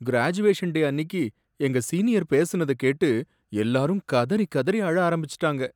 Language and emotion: Tamil, sad